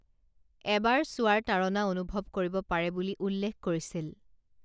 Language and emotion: Assamese, neutral